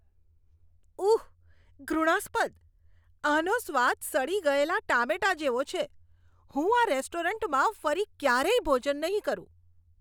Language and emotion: Gujarati, disgusted